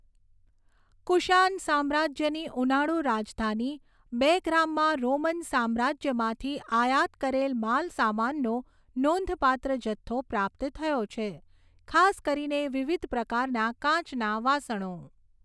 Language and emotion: Gujarati, neutral